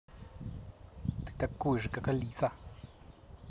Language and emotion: Russian, angry